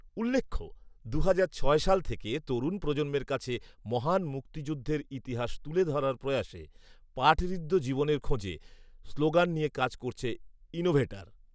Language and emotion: Bengali, neutral